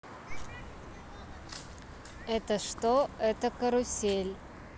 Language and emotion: Russian, neutral